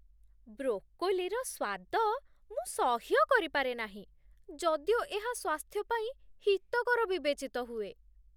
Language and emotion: Odia, disgusted